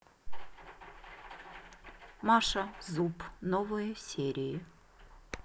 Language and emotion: Russian, neutral